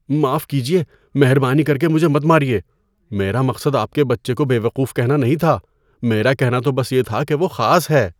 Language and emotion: Urdu, fearful